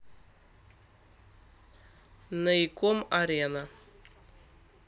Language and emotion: Russian, neutral